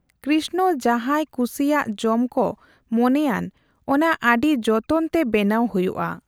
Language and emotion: Santali, neutral